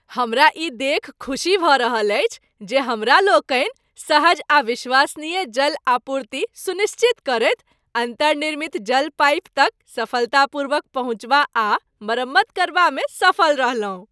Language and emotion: Maithili, happy